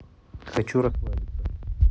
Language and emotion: Russian, neutral